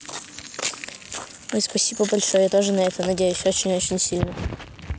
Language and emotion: Russian, neutral